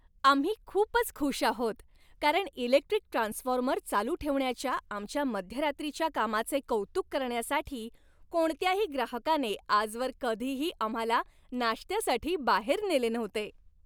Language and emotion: Marathi, happy